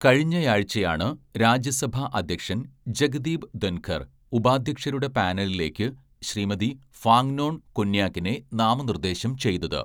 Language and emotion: Malayalam, neutral